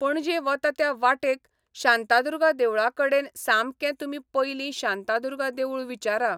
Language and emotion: Goan Konkani, neutral